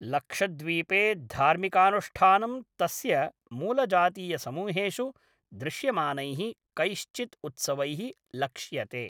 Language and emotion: Sanskrit, neutral